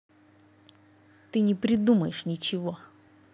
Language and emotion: Russian, angry